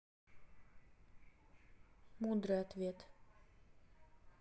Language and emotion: Russian, neutral